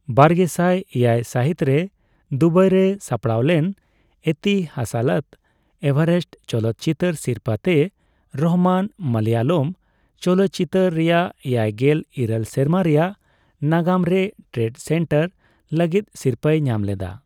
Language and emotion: Santali, neutral